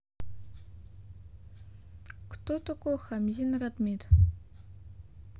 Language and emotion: Russian, neutral